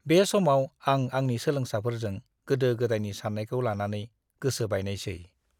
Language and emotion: Bodo, disgusted